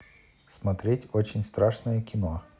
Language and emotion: Russian, neutral